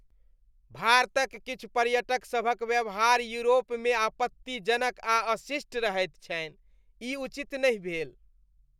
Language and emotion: Maithili, disgusted